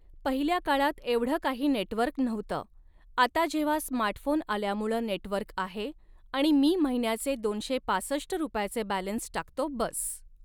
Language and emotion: Marathi, neutral